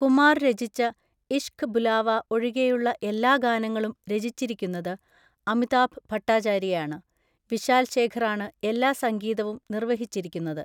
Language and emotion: Malayalam, neutral